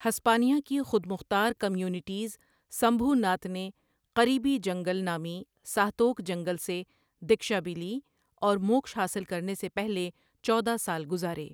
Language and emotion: Urdu, neutral